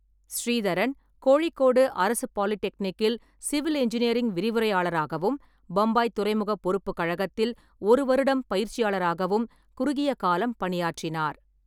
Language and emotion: Tamil, neutral